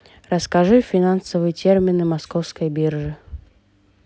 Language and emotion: Russian, neutral